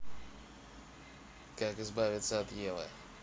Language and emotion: Russian, neutral